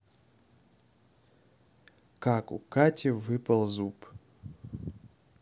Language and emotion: Russian, neutral